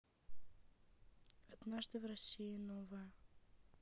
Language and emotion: Russian, neutral